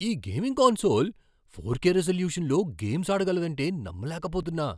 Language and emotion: Telugu, surprised